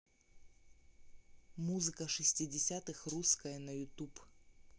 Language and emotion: Russian, neutral